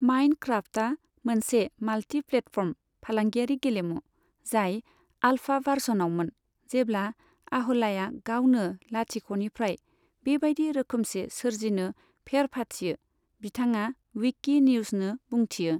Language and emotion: Bodo, neutral